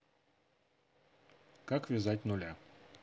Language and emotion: Russian, neutral